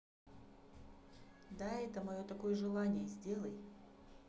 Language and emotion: Russian, neutral